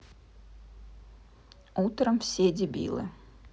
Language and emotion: Russian, neutral